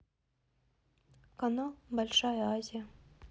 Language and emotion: Russian, neutral